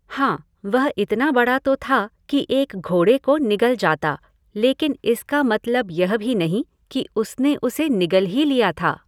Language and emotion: Hindi, neutral